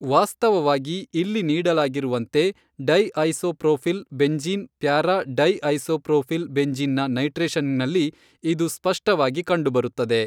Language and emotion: Kannada, neutral